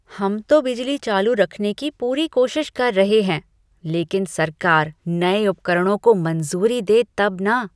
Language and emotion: Hindi, disgusted